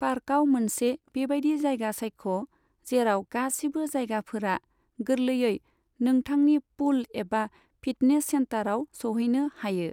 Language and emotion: Bodo, neutral